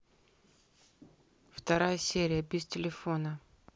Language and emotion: Russian, neutral